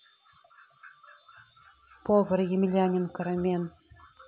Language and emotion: Russian, neutral